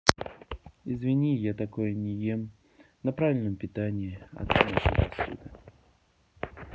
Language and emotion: Russian, neutral